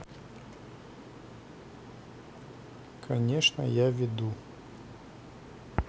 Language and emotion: Russian, neutral